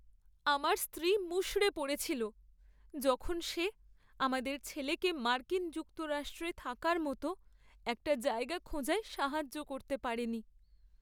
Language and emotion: Bengali, sad